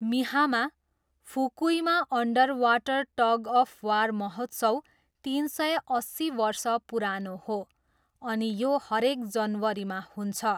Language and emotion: Nepali, neutral